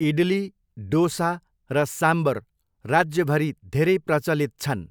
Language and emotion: Nepali, neutral